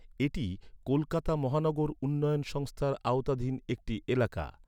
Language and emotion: Bengali, neutral